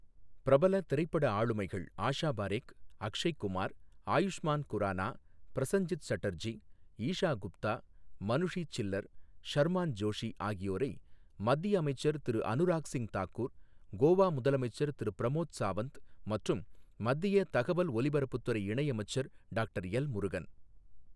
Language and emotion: Tamil, neutral